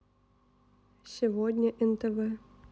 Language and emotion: Russian, neutral